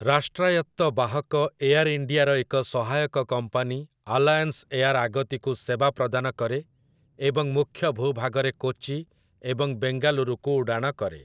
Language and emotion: Odia, neutral